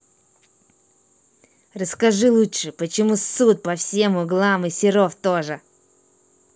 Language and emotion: Russian, angry